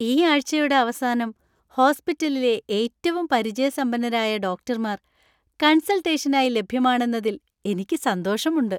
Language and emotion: Malayalam, happy